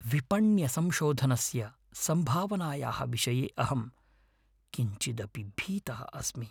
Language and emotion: Sanskrit, fearful